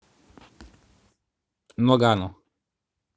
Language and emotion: Russian, neutral